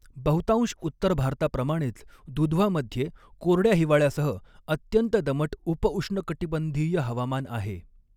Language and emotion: Marathi, neutral